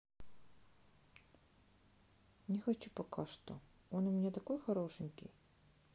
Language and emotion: Russian, sad